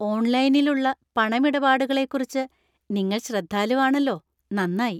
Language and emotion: Malayalam, happy